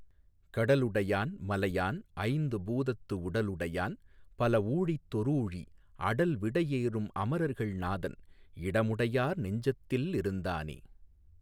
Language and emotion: Tamil, neutral